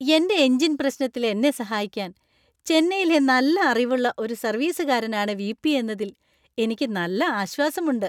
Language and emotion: Malayalam, happy